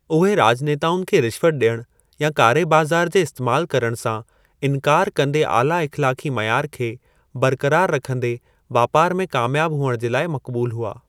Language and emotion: Sindhi, neutral